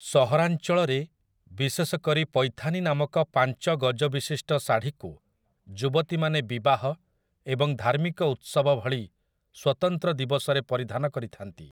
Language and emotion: Odia, neutral